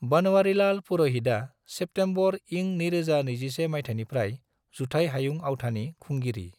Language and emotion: Bodo, neutral